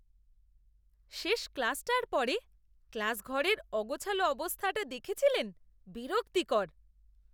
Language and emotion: Bengali, disgusted